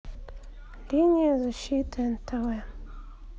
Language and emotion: Russian, neutral